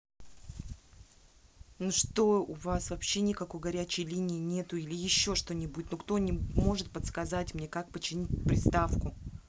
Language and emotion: Russian, angry